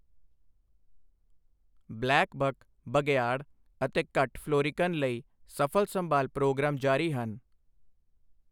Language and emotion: Punjabi, neutral